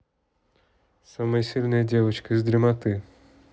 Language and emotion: Russian, neutral